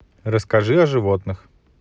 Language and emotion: Russian, neutral